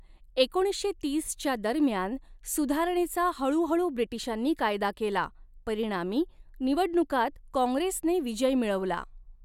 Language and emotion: Marathi, neutral